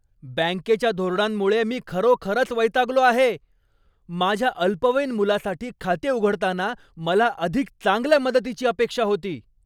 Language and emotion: Marathi, angry